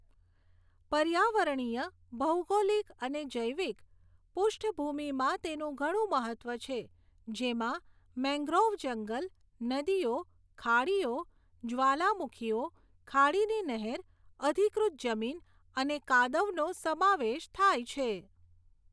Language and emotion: Gujarati, neutral